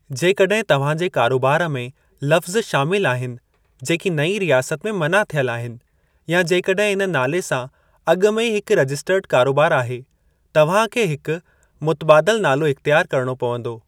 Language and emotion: Sindhi, neutral